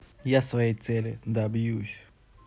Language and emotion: Russian, angry